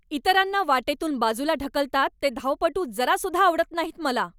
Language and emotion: Marathi, angry